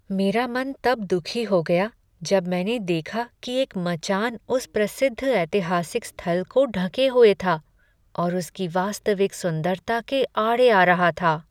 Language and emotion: Hindi, sad